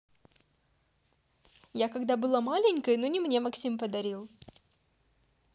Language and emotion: Russian, positive